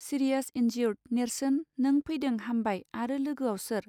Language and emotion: Bodo, neutral